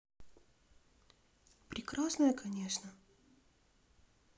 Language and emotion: Russian, sad